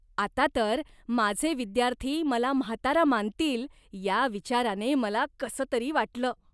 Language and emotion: Marathi, disgusted